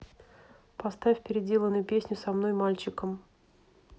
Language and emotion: Russian, neutral